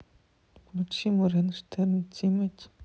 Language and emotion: Russian, sad